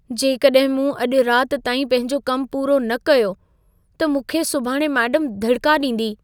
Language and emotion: Sindhi, fearful